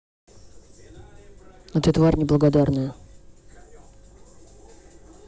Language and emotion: Russian, angry